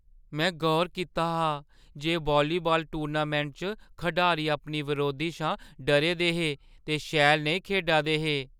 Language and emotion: Dogri, fearful